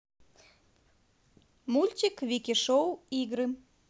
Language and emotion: Russian, positive